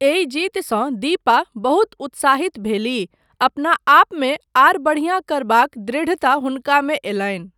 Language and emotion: Maithili, neutral